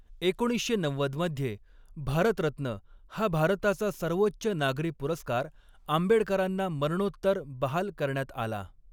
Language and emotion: Marathi, neutral